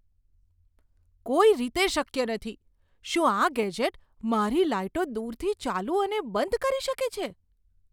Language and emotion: Gujarati, surprised